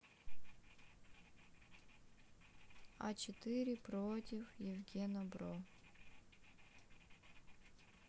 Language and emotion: Russian, sad